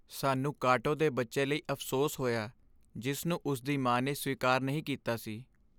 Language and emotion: Punjabi, sad